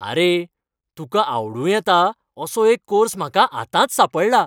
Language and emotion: Goan Konkani, happy